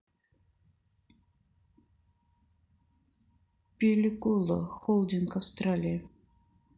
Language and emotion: Russian, neutral